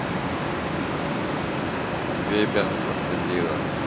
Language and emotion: Russian, neutral